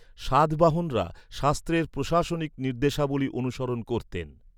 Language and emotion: Bengali, neutral